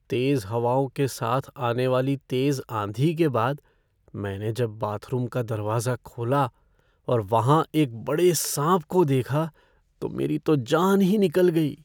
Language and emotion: Hindi, fearful